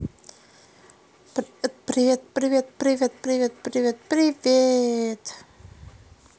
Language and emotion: Russian, positive